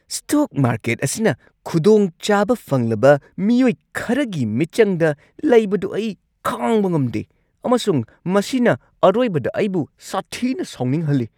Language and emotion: Manipuri, angry